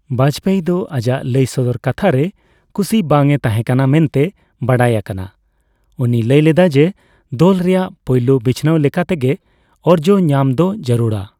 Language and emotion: Santali, neutral